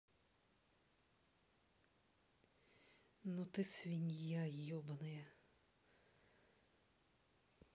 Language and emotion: Russian, neutral